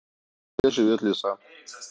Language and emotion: Russian, neutral